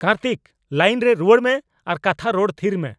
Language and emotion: Santali, angry